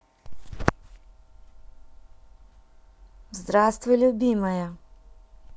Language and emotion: Russian, positive